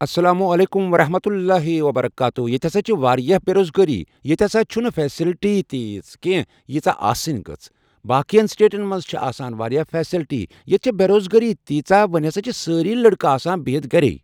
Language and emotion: Kashmiri, neutral